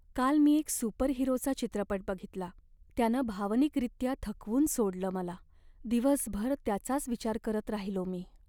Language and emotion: Marathi, sad